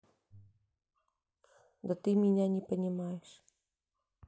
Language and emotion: Russian, sad